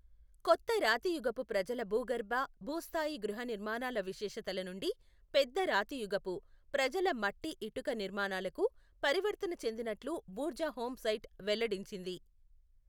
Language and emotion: Telugu, neutral